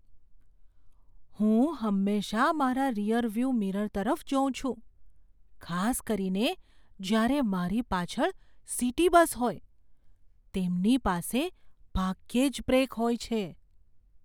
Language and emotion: Gujarati, fearful